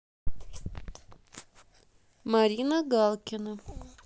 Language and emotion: Russian, neutral